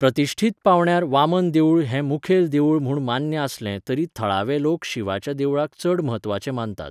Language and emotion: Goan Konkani, neutral